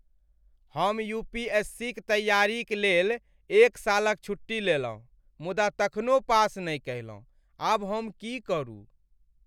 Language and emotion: Maithili, sad